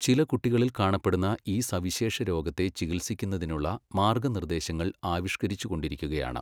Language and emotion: Malayalam, neutral